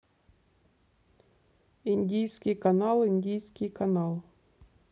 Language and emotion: Russian, neutral